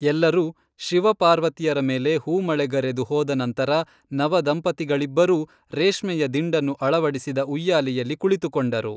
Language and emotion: Kannada, neutral